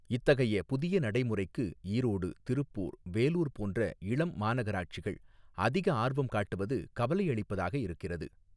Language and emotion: Tamil, neutral